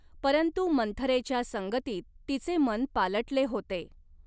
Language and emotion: Marathi, neutral